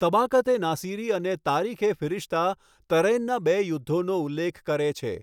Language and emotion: Gujarati, neutral